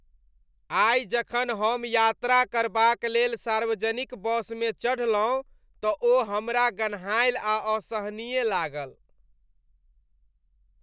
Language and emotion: Maithili, disgusted